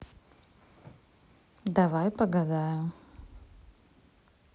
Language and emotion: Russian, neutral